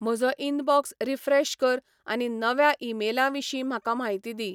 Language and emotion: Goan Konkani, neutral